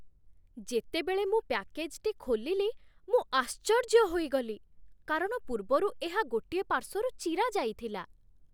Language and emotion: Odia, surprised